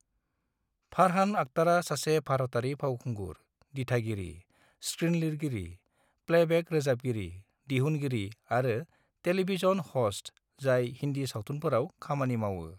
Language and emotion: Bodo, neutral